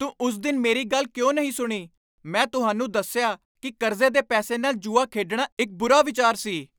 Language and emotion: Punjabi, angry